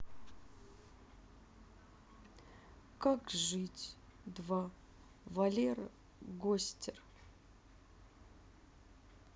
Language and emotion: Russian, sad